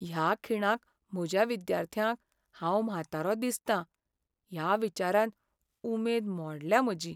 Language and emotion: Goan Konkani, sad